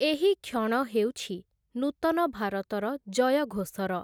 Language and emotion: Odia, neutral